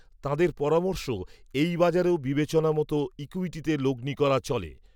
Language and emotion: Bengali, neutral